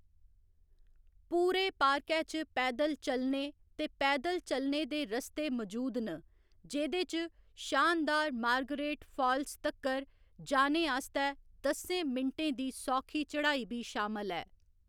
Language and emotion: Dogri, neutral